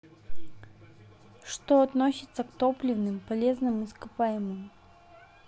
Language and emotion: Russian, neutral